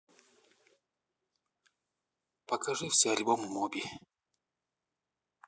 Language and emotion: Russian, neutral